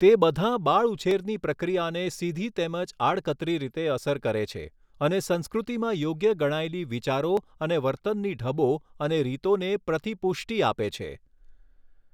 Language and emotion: Gujarati, neutral